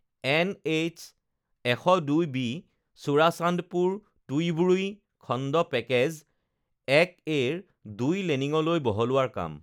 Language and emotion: Assamese, neutral